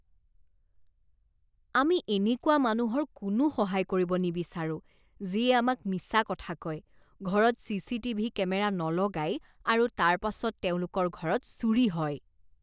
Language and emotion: Assamese, disgusted